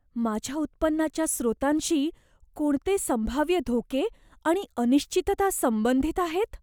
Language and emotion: Marathi, fearful